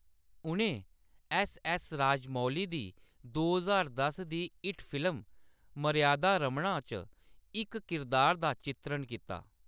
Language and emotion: Dogri, neutral